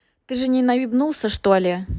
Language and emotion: Russian, neutral